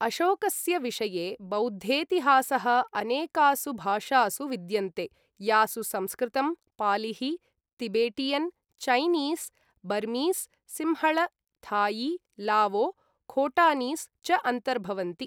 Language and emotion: Sanskrit, neutral